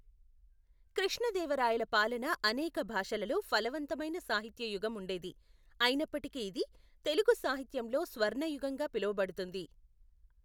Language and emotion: Telugu, neutral